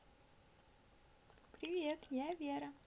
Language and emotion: Russian, positive